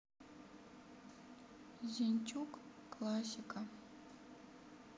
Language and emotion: Russian, sad